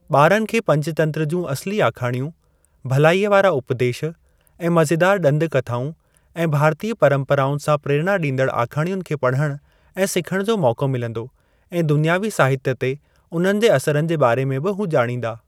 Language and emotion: Sindhi, neutral